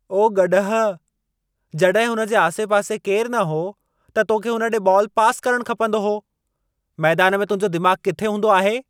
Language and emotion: Sindhi, angry